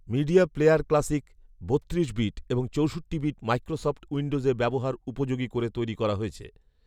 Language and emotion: Bengali, neutral